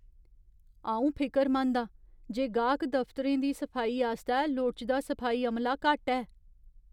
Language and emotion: Dogri, fearful